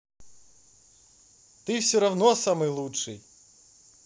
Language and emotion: Russian, positive